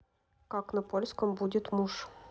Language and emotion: Russian, neutral